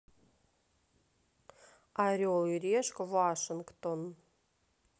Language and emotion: Russian, neutral